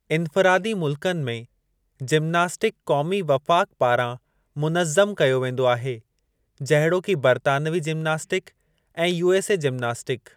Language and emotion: Sindhi, neutral